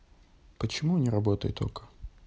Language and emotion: Russian, neutral